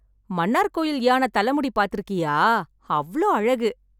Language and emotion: Tamil, happy